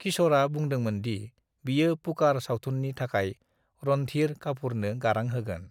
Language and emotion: Bodo, neutral